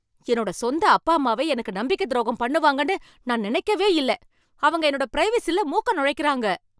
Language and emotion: Tamil, angry